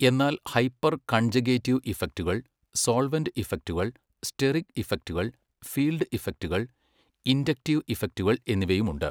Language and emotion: Malayalam, neutral